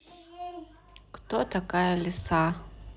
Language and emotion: Russian, neutral